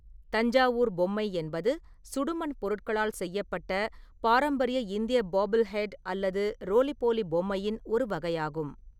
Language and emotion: Tamil, neutral